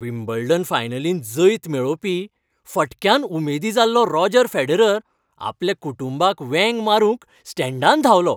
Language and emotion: Goan Konkani, happy